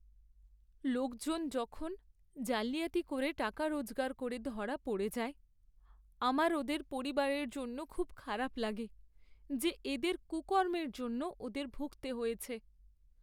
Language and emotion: Bengali, sad